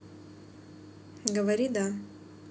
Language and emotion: Russian, neutral